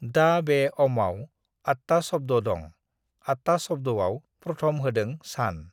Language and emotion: Bodo, neutral